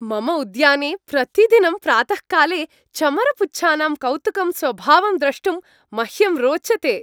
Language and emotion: Sanskrit, happy